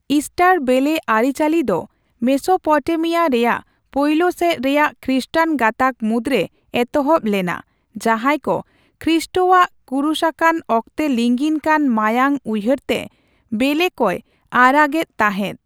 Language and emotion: Santali, neutral